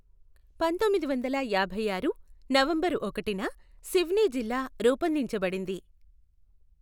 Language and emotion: Telugu, neutral